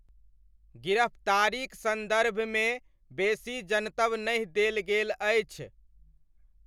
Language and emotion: Maithili, neutral